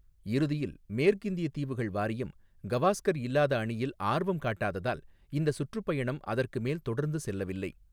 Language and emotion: Tamil, neutral